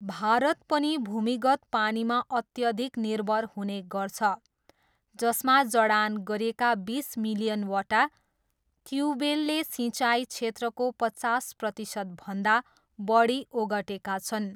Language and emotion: Nepali, neutral